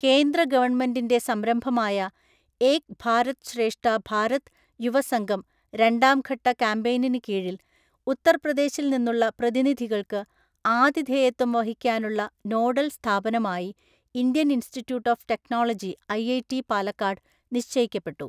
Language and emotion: Malayalam, neutral